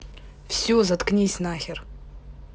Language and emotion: Russian, angry